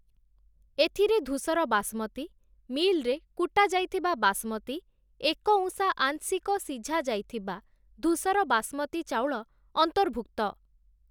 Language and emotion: Odia, neutral